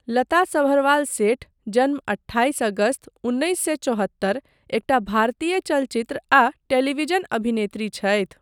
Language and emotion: Maithili, neutral